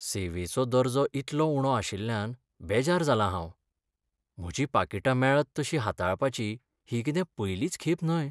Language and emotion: Goan Konkani, sad